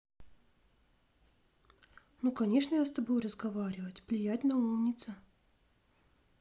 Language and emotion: Russian, positive